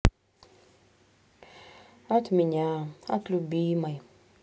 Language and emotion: Russian, sad